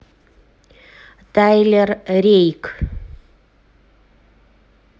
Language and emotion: Russian, neutral